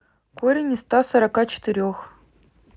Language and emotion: Russian, neutral